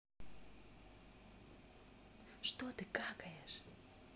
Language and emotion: Russian, neutral